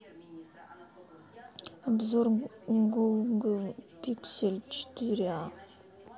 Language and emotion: Russian, sad